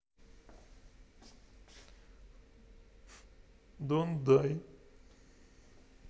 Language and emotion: Russian, neutral